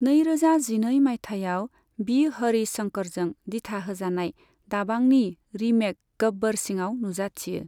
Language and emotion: Bodo, neutral